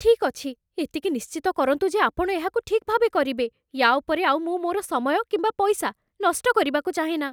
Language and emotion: Odia, fearful